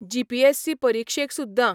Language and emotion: Goan Konkani, neutral